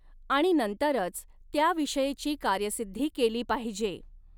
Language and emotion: Marathi, neutral